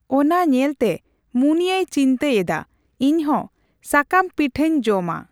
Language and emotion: Santali, neutral